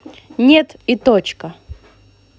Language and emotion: Russian, angry